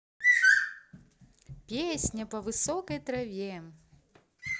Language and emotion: Russian, positive